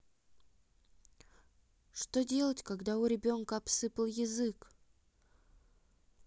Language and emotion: Russian, sad